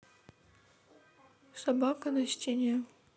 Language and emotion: Russian, sad